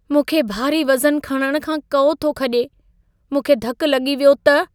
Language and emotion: Sindhi, fearful